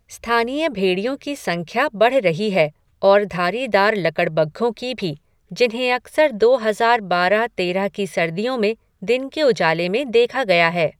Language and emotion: Hindi, neutral